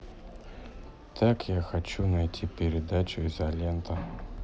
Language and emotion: Russian, neutral